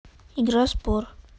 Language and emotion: Russian, neutral